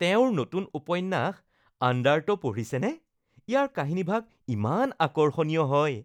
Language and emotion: Assamese, happy